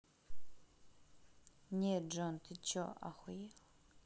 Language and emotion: Russian, neutral